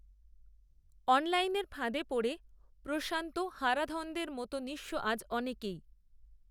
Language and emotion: Bengali, neutral